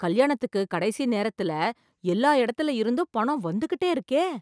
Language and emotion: Tamil, surprised